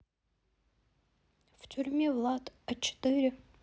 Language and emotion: Russian, sad